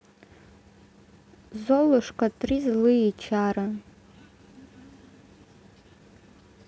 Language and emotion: Russian, neutral